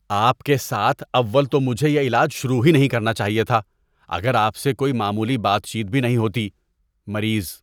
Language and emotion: Urdu, disgusted